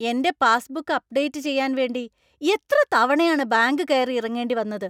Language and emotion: Malayalam, angry